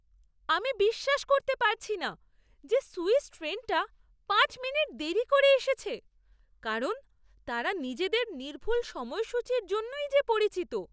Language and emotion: Bengali, surprised